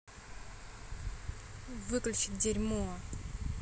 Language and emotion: Russian, angry